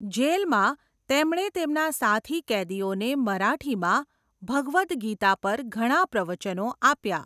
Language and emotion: Gujarati, neutral